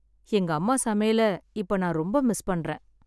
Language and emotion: Tamil, sad